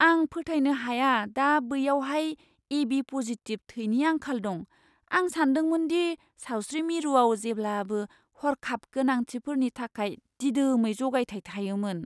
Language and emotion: Bodo, surprised